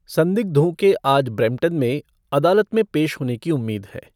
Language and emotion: Hindi, neutral